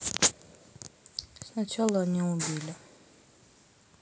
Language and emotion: Russian, sad